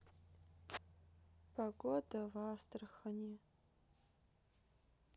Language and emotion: Russian, sad